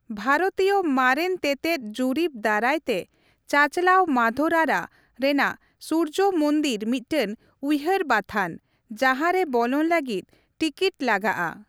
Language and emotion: Santali, neutral